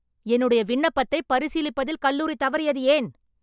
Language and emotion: Tamil, angry